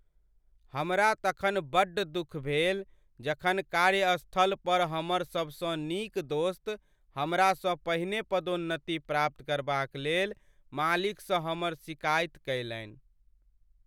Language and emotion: Maithili, sad